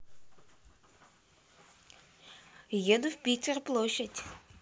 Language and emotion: Russian, positive